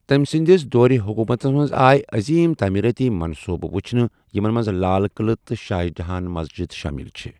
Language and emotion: Kashmiri, neutral